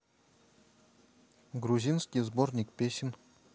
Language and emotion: Russian, neutral